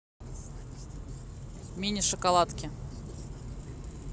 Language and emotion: Russian, neutral